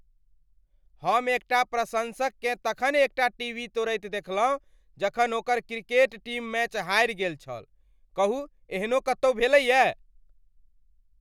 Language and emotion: Maithili, angry